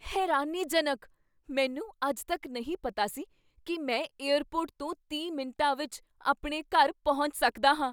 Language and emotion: Punjabi, surprised